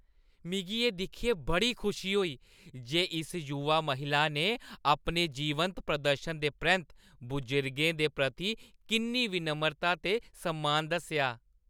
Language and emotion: Dogri, happy